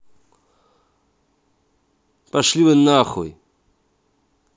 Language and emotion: Russian, angry